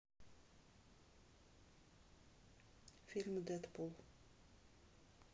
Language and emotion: Russian, neutral